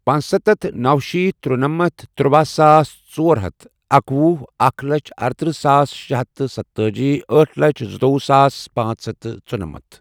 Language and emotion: Kashmiri, neutral